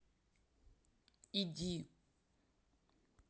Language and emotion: Russian, neutral